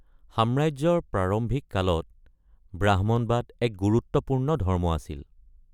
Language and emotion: Assamese, neutral